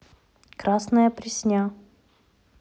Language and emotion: Russian, neutral